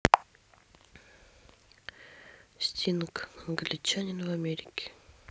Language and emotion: Russian, neutral